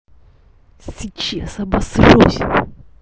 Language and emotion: Russian, angry